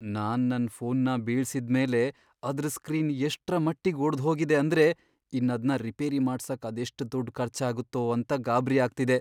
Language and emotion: Kannada, fearful